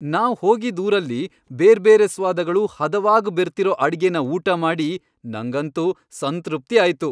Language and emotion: Kannada, happy